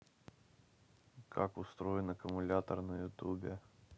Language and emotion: Russian, neutral